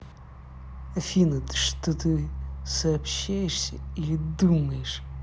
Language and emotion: Russian, angry